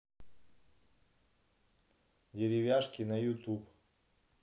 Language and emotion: Russian, neutral